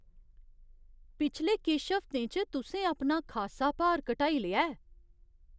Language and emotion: Dogri, surprised